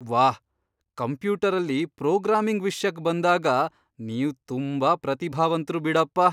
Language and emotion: Kannada, surprised